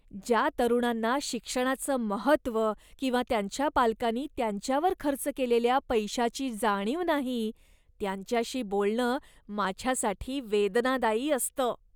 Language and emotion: Marathi, disgusted